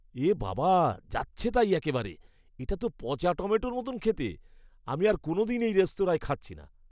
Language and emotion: Bengali, disgusted